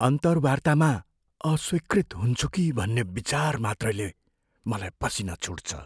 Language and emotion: Nepali, fearful